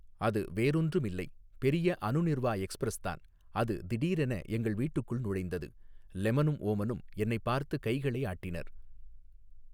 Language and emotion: Tamil, neutral